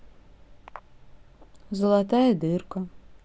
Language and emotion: Russian, neutral